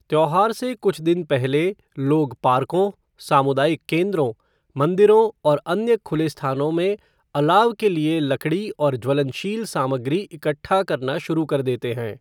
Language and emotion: Hindi, neutral